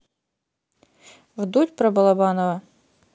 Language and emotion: Russian, neutral